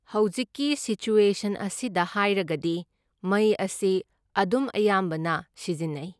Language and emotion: Manipuri, neutral